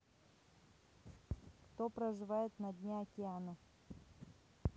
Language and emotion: Russian, neutral